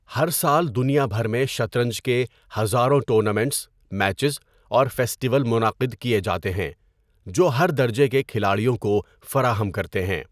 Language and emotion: Urdu, neutral